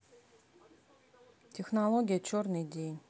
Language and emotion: Russian, neutral